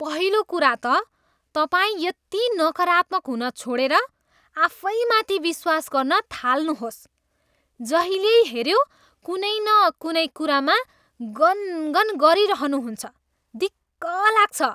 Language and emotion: Nepali, disgusted